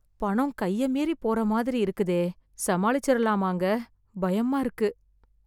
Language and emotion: Tamil, fearful